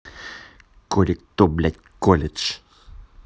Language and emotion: Russian, angry